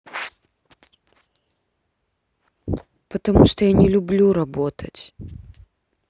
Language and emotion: Russian, sad